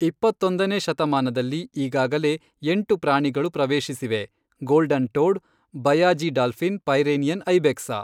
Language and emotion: Kannada, neutral